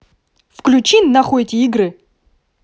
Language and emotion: Russian, angry